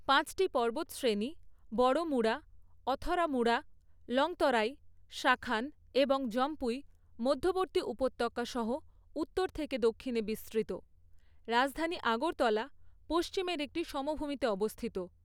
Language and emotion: Bengali, neutral